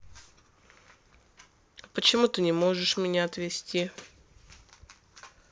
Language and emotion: Russian, neutral